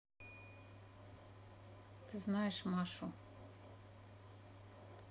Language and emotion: Russian, neutral